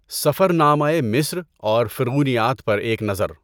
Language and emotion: Urdu, neutral